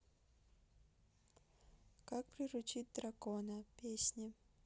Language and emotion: Russian, neutral